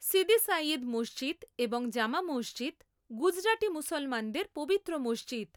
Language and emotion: Bengali, neutral